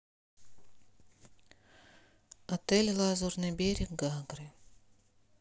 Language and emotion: Russian, sad